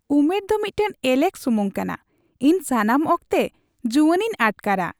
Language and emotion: Santali, happy